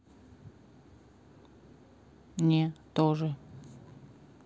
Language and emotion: Russian, neutral